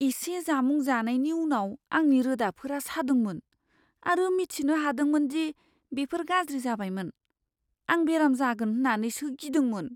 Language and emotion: Bodo, fearful